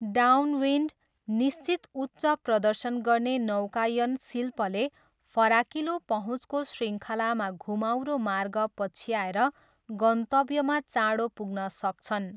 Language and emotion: Nepali, neutral